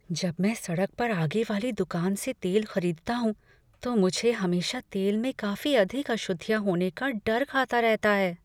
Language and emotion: Hindi, fearful